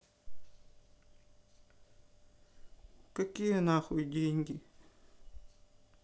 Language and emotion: Russian, angry